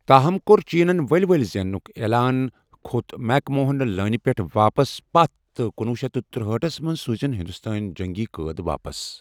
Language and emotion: Kashmiri, neutral